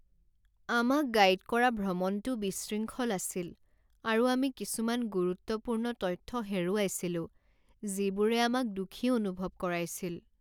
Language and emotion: Assamese, sad